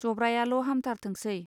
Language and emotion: Bodo, neutral